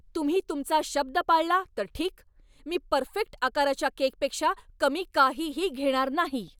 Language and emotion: Marathi, angry